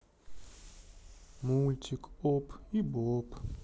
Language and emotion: Russian, sad